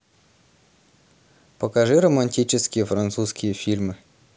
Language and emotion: Russian, neutral